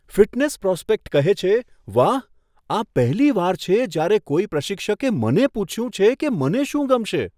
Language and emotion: Gujarati, surprised